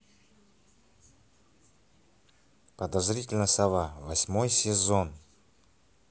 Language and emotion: Russian, neutral